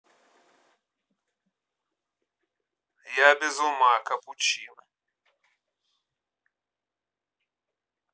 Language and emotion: Russian, neutral